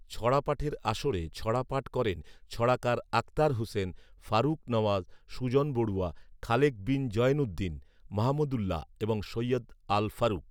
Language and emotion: Bengali, neutral